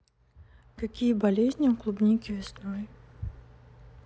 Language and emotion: Russian, neutral